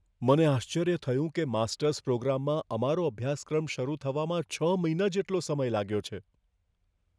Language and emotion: Gujarati, fearful